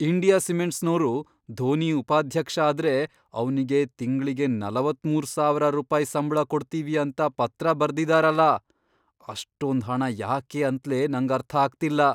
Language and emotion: Kannada, surprised